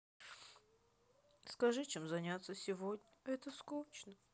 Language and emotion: Russian, sad